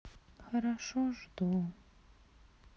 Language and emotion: Russian, sad